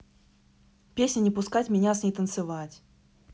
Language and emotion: Russian, neutral